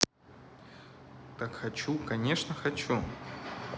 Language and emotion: Russian, neutral